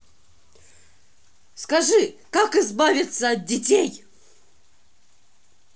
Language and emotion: Russian, angry